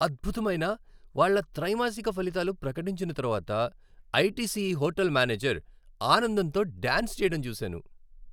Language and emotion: Telugu, happy